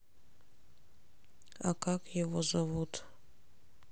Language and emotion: Russian, sad